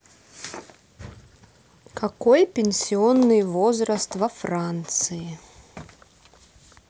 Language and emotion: Russian, neutral